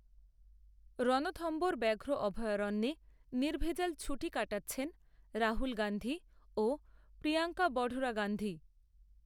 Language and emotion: Bengali, neutral